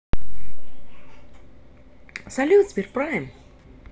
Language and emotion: Russian, positive